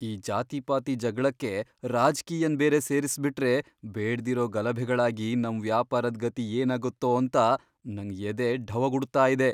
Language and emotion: Kannada, fearful